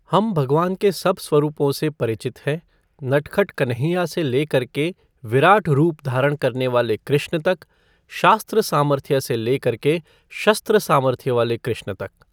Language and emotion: Hindi, neutral